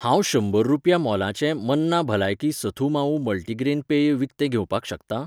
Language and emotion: Goan Konkani, neutral